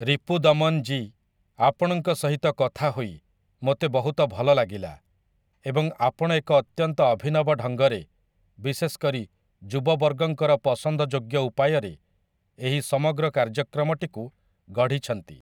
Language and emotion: Odia, neutral